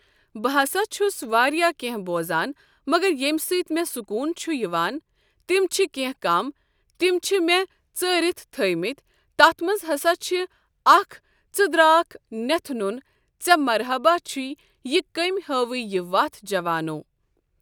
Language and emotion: Kashmiri, neutral